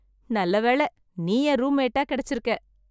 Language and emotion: Tamil, happy